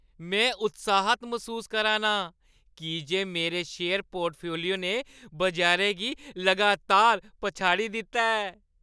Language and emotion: Dogri, happy